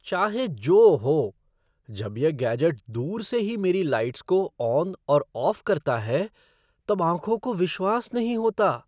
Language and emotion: Hindi, surprised